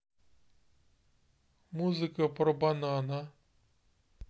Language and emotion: Russian, neutral